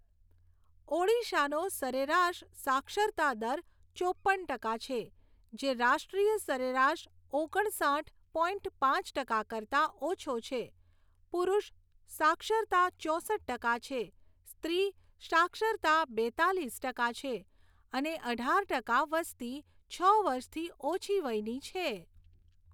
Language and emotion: Gujarati, neutral